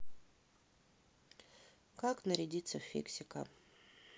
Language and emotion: Russian, neutral